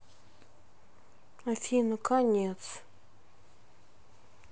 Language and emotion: Russian, sad